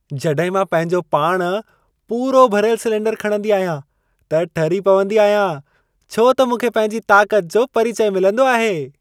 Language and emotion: Sindhi, happy